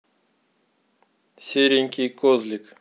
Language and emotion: Russian, neutral